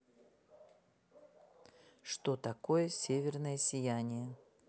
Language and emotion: Russian, neutral